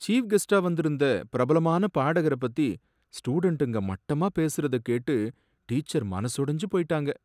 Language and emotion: Tamil, sad